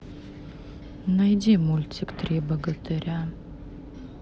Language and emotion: Russian, sad